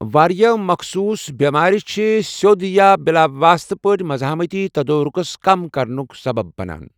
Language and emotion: Kashmiri, neutral